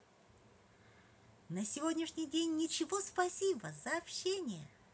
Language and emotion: Russian, positive